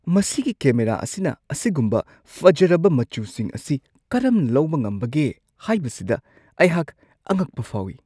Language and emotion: Manipuri, surprised